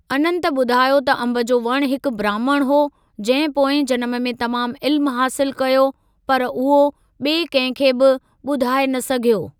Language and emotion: Sindhi, neutral